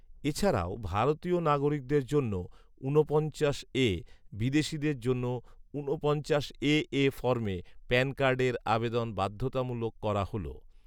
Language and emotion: Bengali, neutral